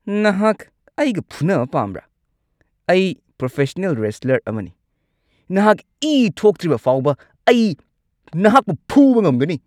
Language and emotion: Manipuri, angry